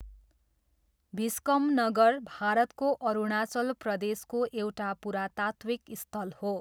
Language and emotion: Nepali, neutral